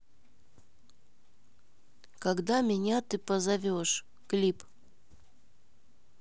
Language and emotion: Russian, neutral